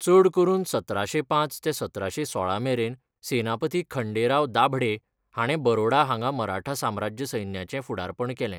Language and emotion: Goan Konkani, neutral